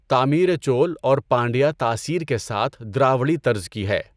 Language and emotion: Urdu, neutral